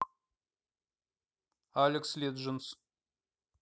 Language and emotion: Russian, neutral